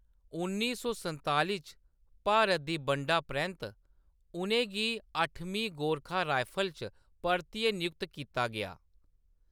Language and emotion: Dogri, neutral